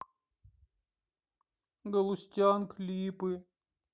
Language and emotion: Russian, sad